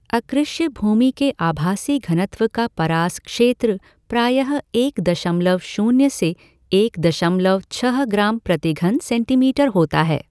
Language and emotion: Hindi, neutral